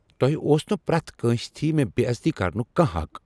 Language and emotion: Kashmiri, angry